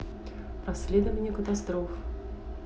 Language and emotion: Russian, neutral